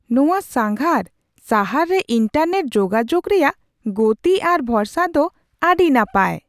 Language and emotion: Santali, surprised